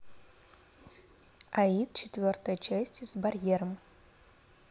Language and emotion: Russian, neutral